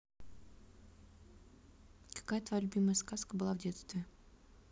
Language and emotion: Russian, neutral